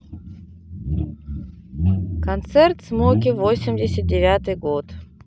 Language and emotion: Russian, neutral